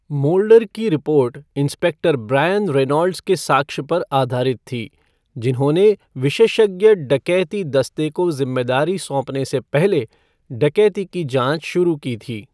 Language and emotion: Hindi, neutral